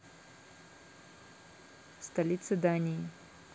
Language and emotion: Russian, neutral